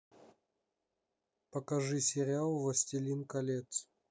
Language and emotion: Russian, neutral